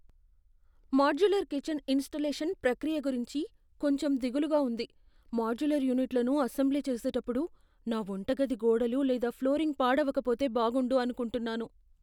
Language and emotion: Telugu, fearful